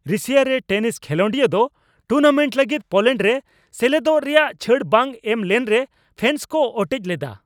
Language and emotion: Santali, angry